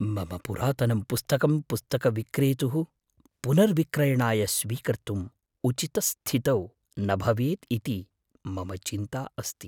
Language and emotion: Sanskrit, fearful